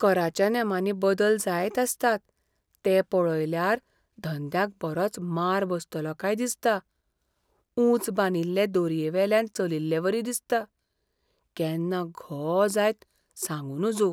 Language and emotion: Goan Konkani, fearful